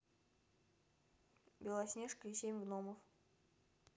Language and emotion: Russian, neutral